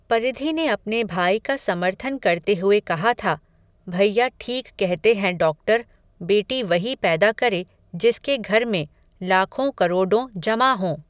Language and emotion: Hindi, neutral